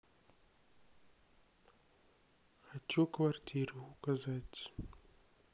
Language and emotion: Russian, sad